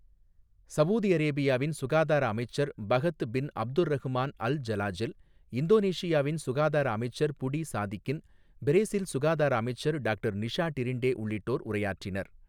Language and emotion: Tamil, neutral